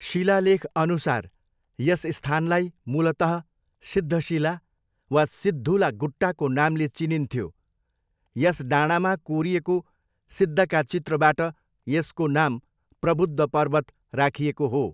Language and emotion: Nepali, neutral